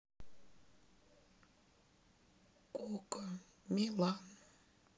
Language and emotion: Russian, sad